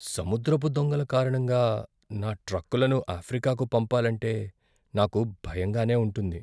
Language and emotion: Telugu, fearful